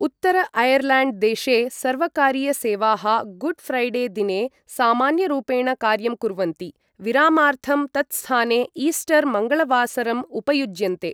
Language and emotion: Sanskrit, neutral